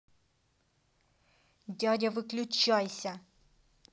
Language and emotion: Russian, angry